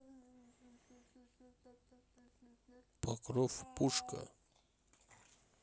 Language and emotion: Russian, neutral